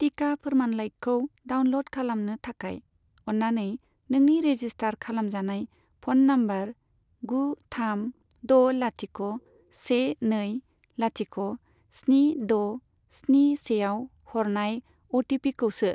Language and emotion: Bodo, neutral